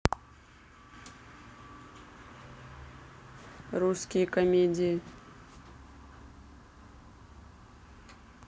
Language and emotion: Russian, neutral